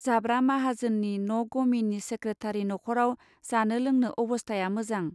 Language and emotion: Bodo, neutral